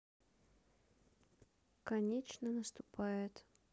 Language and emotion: Russian, sad